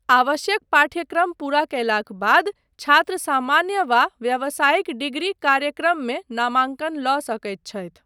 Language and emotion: Maithili, neutral